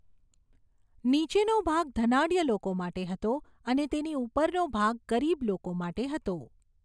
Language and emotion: Gujarati, neutral